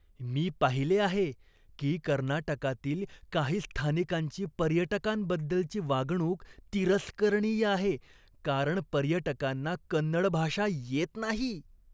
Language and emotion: Marathi, disgusted